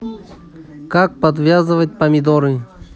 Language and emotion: Russian, neutral